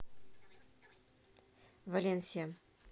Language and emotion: Russian, neutral